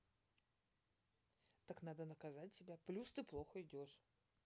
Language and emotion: Russian, neutral